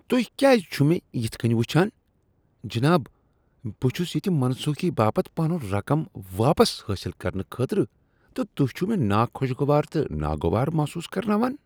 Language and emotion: Kashmiri, disgusted